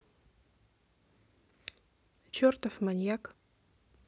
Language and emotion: Russian, neutral